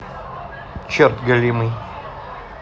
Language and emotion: Russian, neutral